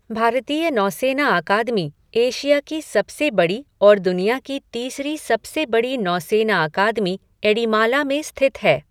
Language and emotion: Hindi, neutral